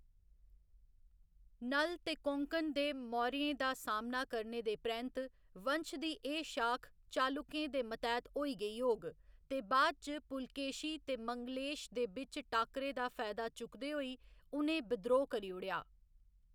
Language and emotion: Dogri, neutral